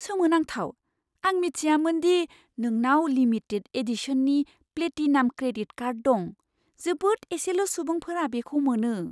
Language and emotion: Bodo, surprised